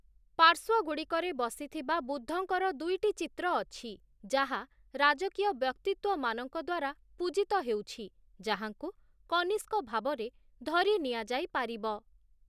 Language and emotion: Odia, neutral